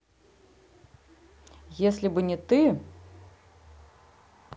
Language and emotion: Russian, neutral